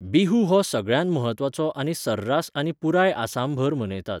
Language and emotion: Goan Konkani, neutral